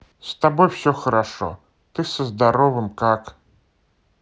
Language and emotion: Russian, neutral